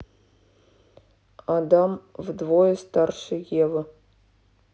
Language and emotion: Russian, neutral